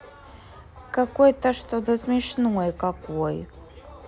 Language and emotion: Russian, neutral